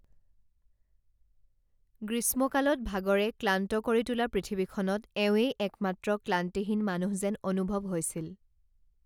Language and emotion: Assamese, neutral